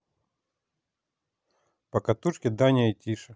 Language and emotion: Russian, neutral